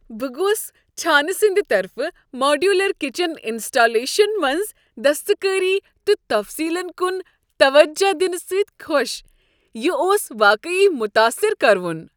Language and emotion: Kashmiri, happy